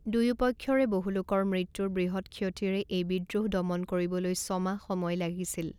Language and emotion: Assamese, neutral